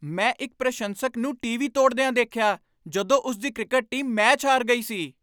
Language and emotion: Punjabi, angry